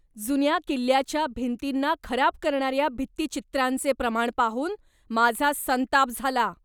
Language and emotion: Marathi, angry